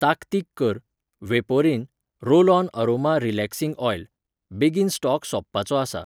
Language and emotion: Goan Konkani, neutral